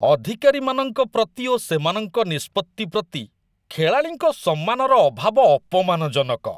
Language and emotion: Odia, disgusted